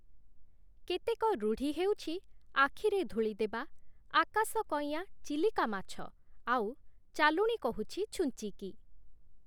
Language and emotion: Odia, neutral